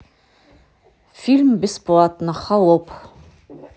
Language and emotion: Russian, neutral